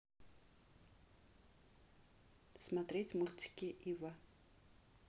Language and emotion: Russian, neutral